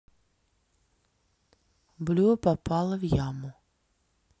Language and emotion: Russian, neutral